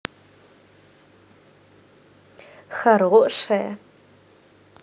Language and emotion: Russian, positive